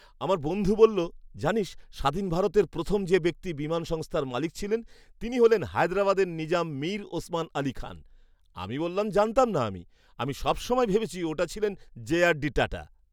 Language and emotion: Bengali, surprised